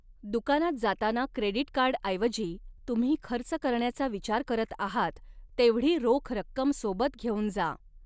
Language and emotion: Marathi, neutral